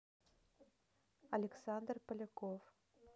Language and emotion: Russian, neutral